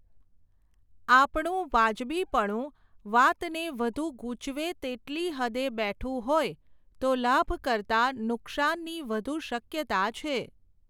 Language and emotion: Gujarati, neutral